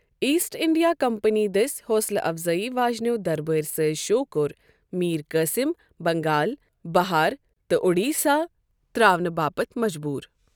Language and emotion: Kashmiri, neutral